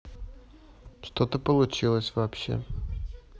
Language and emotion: Russian, neutral